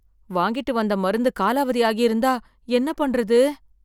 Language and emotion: Tamil, fearful